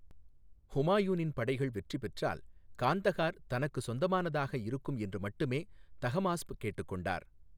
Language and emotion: Tamil, neutral